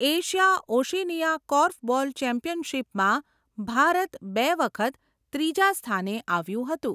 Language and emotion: Gujarati, neutral